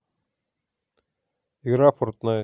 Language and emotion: Russian, neutral